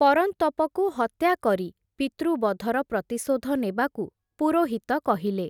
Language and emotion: Odia, neutral